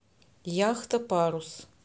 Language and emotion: Russian, neutral